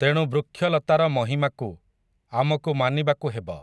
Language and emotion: Odia, neutral